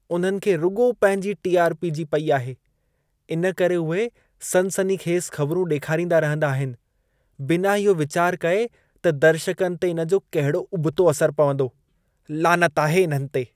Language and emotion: Sindhi, disgusted